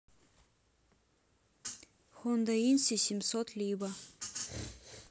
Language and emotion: Russian, neutral